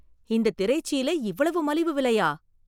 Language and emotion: Tamil, surprised